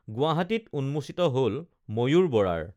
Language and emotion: Assamese, neutral